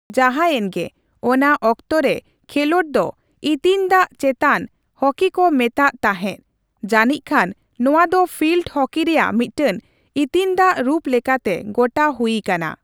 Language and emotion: Santali, neutral